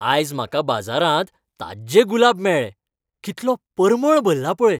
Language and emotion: Goan Konkani, happy